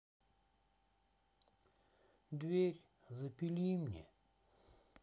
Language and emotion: Russian, sad